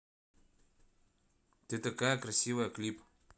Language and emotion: Russian, neutral